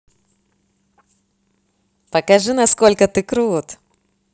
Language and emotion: Russian, positive